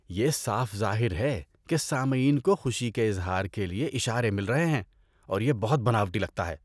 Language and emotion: Urdu, disgusted